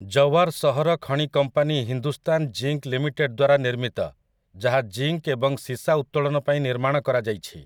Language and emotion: Odia, neutral